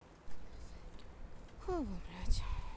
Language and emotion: Russian, sad